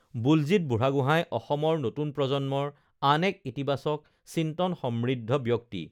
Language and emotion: Assamese, neutral